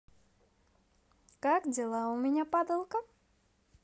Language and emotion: Russian, positive